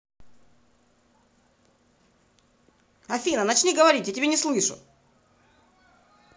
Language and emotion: Russian, angry